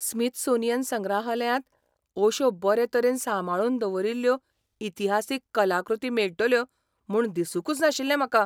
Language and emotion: Goan Konkani, surprised